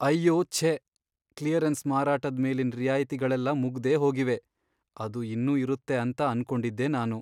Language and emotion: Kannada, sad